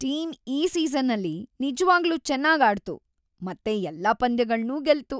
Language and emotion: Kannada, happy